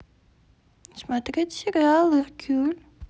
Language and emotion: Russian, neutral